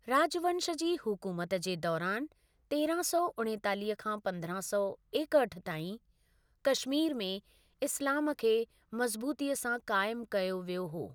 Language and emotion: Sindhi, neutral